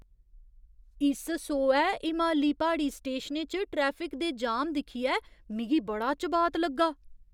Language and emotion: Dogri, surprised